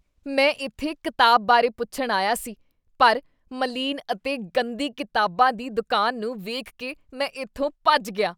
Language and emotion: Punjabi, disgusted